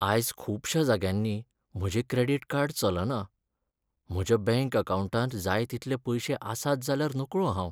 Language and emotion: Goan Konkani, sad